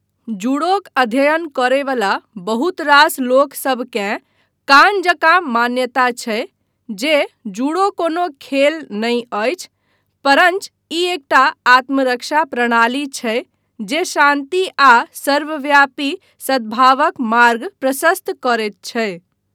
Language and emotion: Maithili, neutral